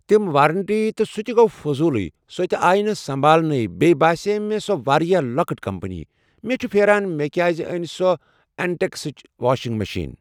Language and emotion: Kashmiri, neutral